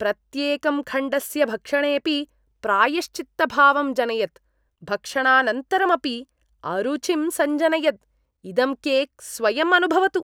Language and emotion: Sanskrit, disgusted